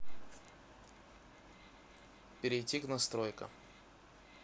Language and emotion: Russian, neutral